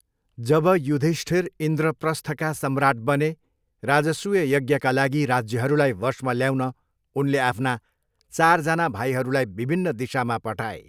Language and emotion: Nepali, neutral